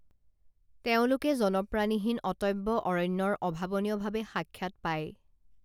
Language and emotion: Assamese, neutral